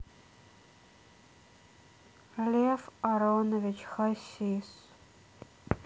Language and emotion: Russian, sad